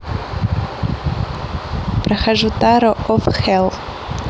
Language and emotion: Russian, neutral